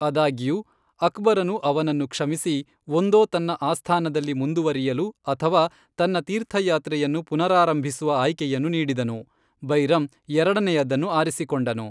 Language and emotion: Kannada, neutral